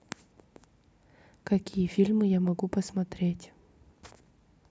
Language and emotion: Russian, neutral